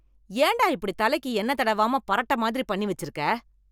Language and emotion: Tamil, angry